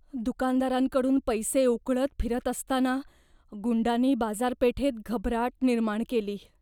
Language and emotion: Marathi, fearful